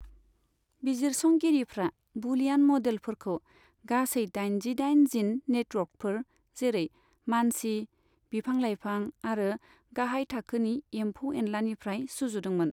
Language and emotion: Bodo, neutral